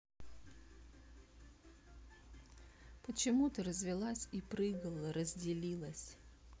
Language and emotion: Russian, sad